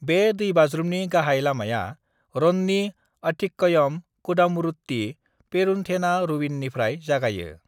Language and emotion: Bodo, neutral